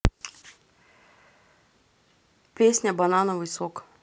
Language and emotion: Russian, neutral